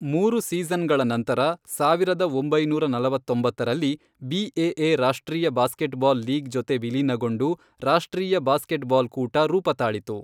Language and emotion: Kannada, neutral